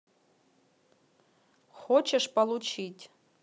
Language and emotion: Russian, neutral